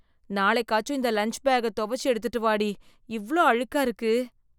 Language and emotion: Tamil, disgusted